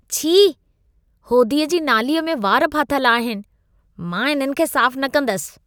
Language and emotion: Sindhi, disgusted